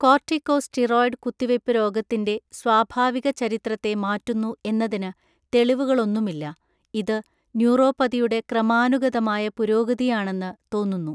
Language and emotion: Malayalam, neutral